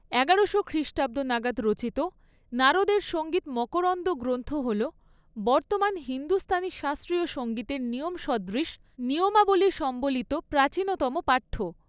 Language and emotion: Bengali, neutral